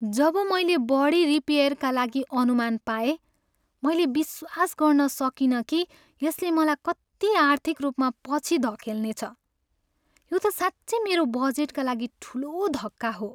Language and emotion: Nepali, sad